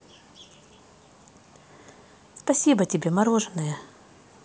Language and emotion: Russian, positive